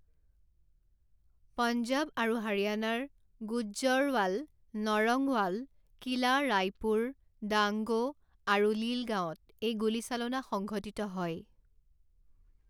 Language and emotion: Assamese, neutral